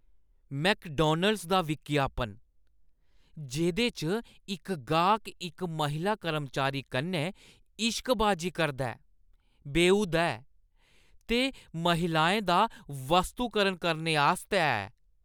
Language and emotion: Dogri, disgusted